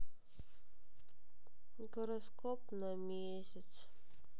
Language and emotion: Russian, sad